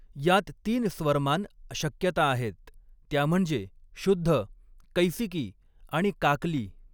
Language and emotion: Marathi, neutral